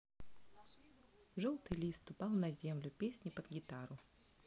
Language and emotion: Russian, neutral